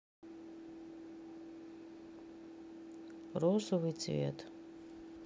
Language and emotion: Russian, sad